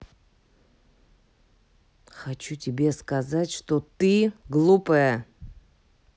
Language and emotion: Russian, angry